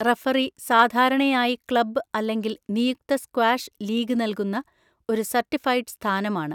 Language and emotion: Malayalam, neutral